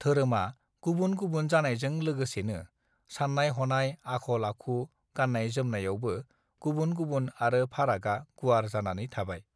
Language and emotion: Bodo, neutral